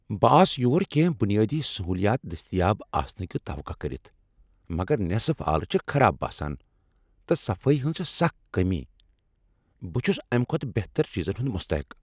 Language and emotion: Kashmiri, angry